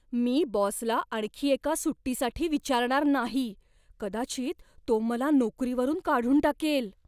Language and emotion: Marathi, fearful